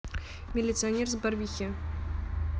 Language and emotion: Russian, neutral